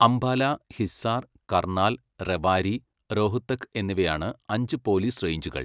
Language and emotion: Malayalam, neutral